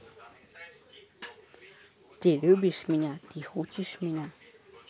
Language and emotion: Russian, neutral